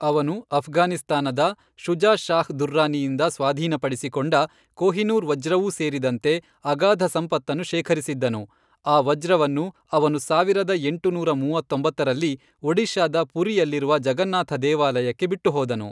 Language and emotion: Kannada, neutral